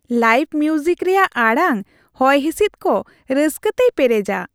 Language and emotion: Santali, happy